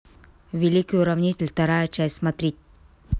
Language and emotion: Russian, neutral